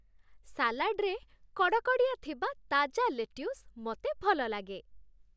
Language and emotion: Odia, happy